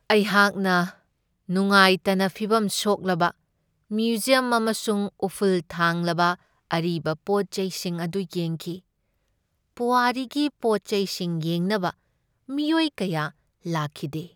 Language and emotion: Manipuri, sad